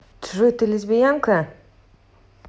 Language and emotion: Russian, angry